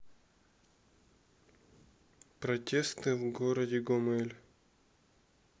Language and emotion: Russian, neutral